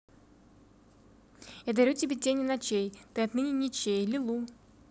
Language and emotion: Russian, neutral